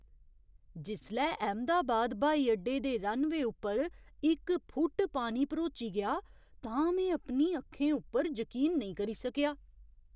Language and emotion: Dogri, surprised